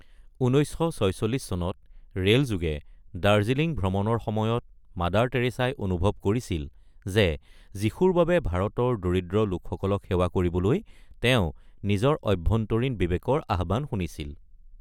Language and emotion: Assamese, neutral